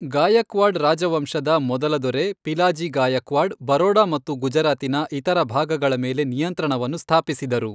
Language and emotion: Kannada, neutral